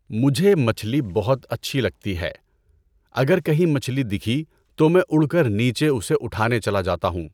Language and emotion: Urdu, neutral